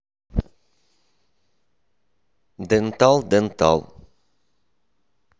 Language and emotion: Russian, neutral